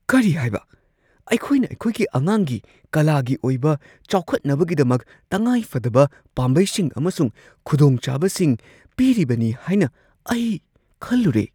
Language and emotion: Manipuri, surprised